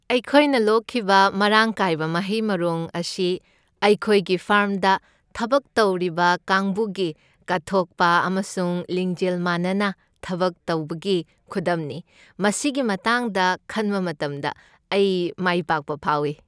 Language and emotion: Manipuri, happy